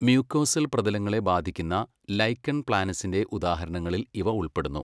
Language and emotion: Malayalam, neutral